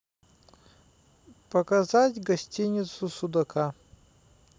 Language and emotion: Russian, neutral